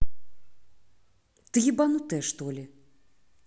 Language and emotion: Russian, angry